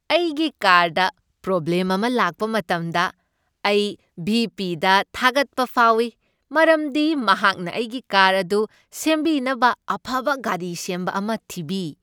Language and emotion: Manipuri, happy